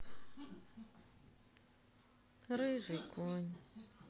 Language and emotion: Russian, sad